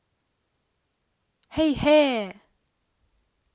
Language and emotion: Russian, positive